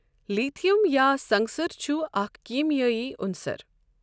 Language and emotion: Kashmiri, neutral